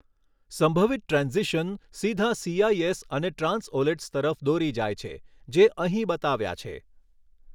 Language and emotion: Gujarati, neutral